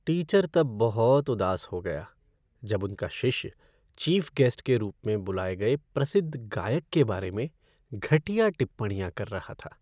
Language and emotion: Hindi, sad